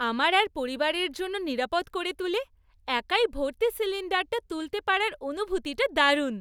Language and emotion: Bengali, happy